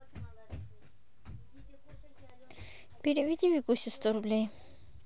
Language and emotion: Russian, neutral